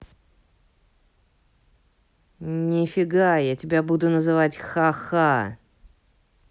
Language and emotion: Russian, neutral